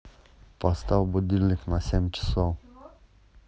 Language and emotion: Russian, neutral